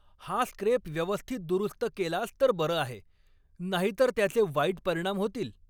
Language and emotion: Marathi, angry